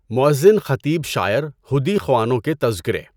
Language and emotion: Urdu, neutral